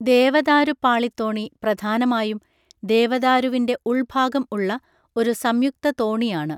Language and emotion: Malayalam, neutral